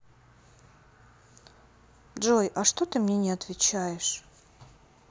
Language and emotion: Russian, sad